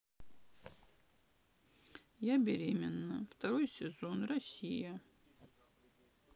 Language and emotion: Russian, sad